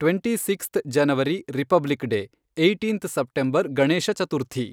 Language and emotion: Kannada, neutral